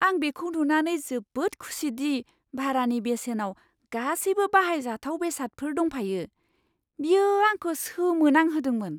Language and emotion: Bodo, surprised